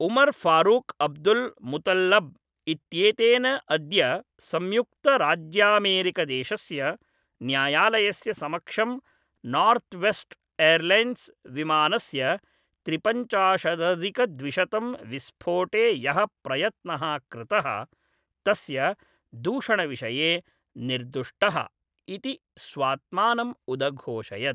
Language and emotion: Sanskrit, neutral